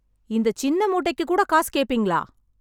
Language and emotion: Tamil, angry